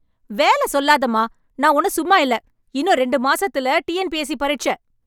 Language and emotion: Tamil, angry